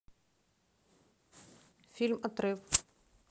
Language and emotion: Russian, neutral